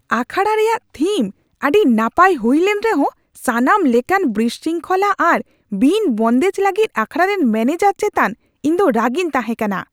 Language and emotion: Santali, angry